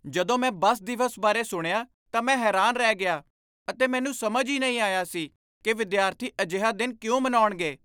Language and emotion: Punjabi, surprised